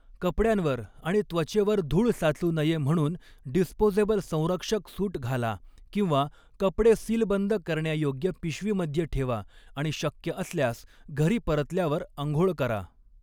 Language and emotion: Marathi, neutral